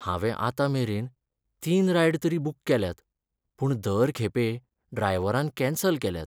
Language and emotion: Goan Konkani, sad